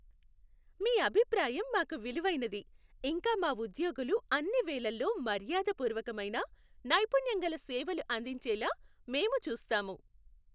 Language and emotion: Telugu, happy